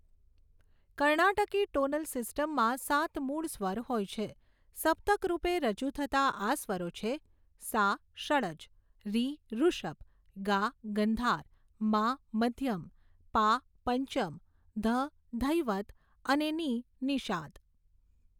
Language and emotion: Gujarati, neutral